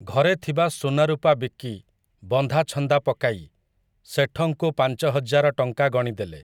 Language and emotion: Odia, neutral